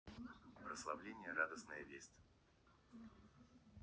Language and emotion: Russian, neutral